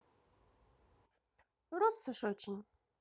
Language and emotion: Russian, neutral